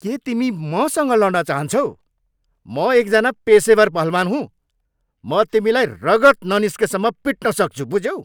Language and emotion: Nepali, angry